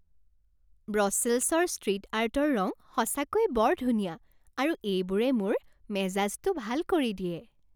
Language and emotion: Assamese, happy